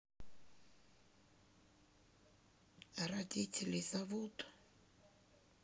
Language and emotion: Russian, neutral